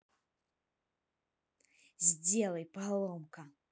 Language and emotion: Russian, angry